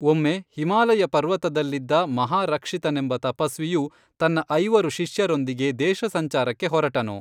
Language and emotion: Kannada, neutral